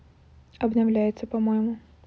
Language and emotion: Russian, neutral